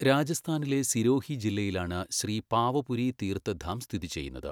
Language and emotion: Malayalam, neutral